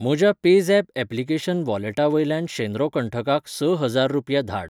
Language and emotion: Goan Konkani, neutral